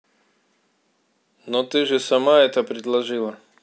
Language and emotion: Russian, neutral